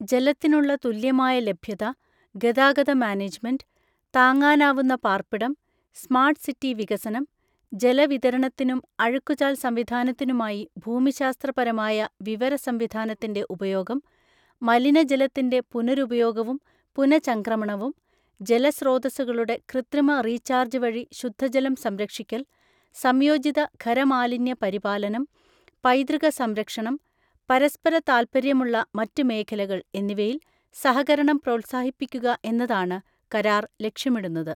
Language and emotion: Malayalam, neutral